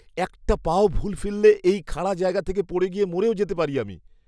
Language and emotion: Bengali, fearful